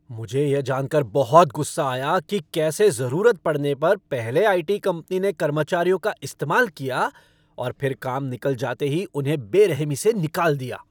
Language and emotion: Hindi, angry